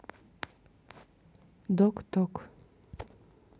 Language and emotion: Russian, neutral